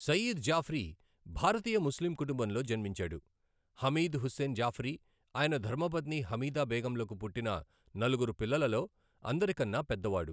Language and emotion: Telugu, neutral